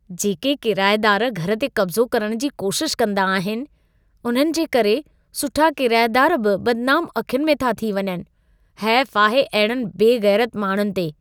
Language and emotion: Sindhi, disgusted